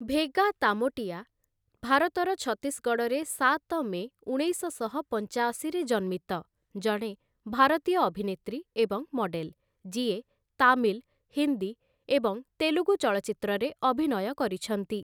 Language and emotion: Odia, neutral